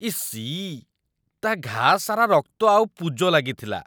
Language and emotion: Odia, disgusted